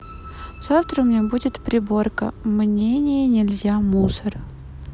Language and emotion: Russian, neutral